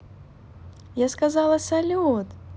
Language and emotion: Russian, positive